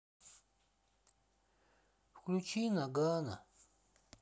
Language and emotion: Russian, sad